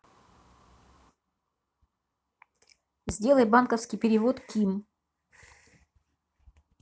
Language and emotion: Russian, neutral